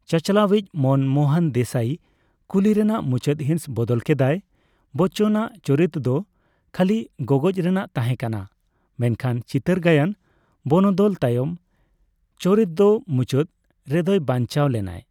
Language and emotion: Santali, neutral